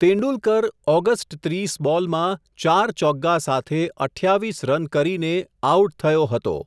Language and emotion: Gujarati, neutral